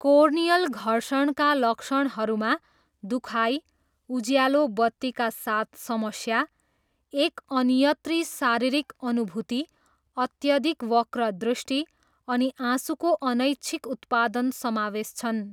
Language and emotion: Nepali, neutral